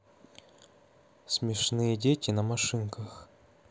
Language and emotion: Russian, neutral